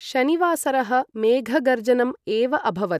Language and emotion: Sanskrit, neutral